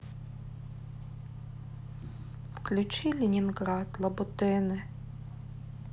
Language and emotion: Russian, sad